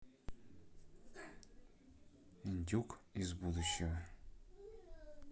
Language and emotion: Russian, neutral